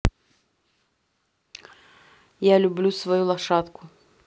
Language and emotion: Russian, neutral